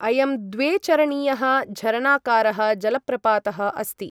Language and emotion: Sanskrit, neutral